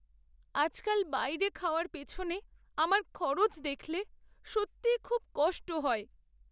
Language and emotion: Bengali, sad